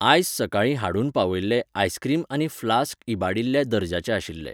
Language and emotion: Goan Konkani, neutral